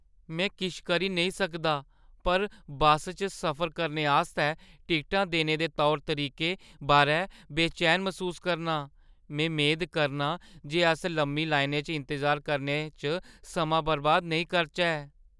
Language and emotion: Dogri, fearful